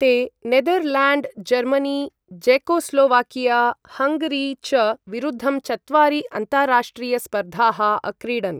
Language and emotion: Sanskrit, neutral